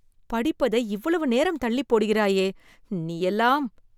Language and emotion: Tamil, disgusted